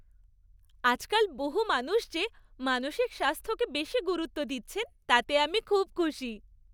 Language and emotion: Bengali, happy